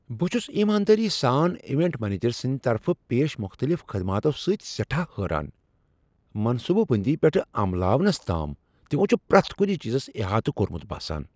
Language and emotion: Kashmiri, surprised